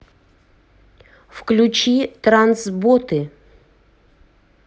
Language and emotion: Russian, neutral